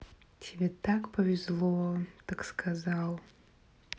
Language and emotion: Russian, neutral